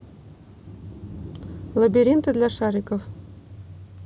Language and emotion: Russian, neutral